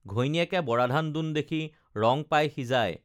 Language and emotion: Assamese, neutral